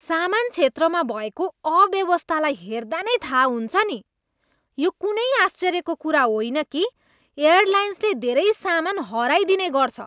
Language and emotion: Nepali, disgusted